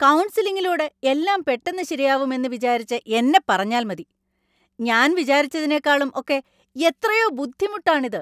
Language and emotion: Malayalam, angry